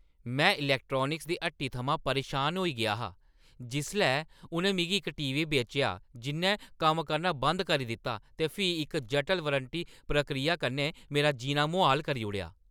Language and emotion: Dogri, angry